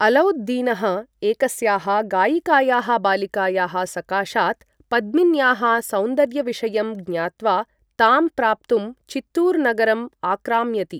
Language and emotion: Sanskrit, neutral